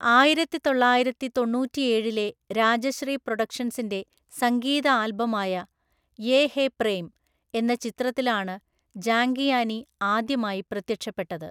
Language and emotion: Malayalam, neutral